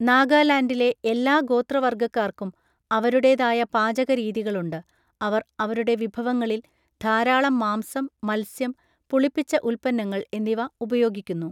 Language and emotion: Malayalam, neutral